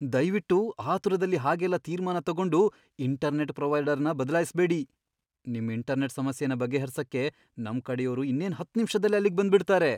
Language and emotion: Kannada, fearful